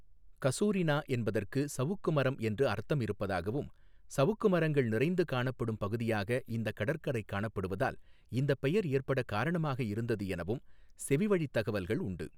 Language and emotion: Tamil, neutral